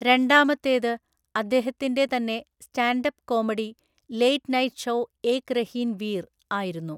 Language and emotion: Malayalam, neutral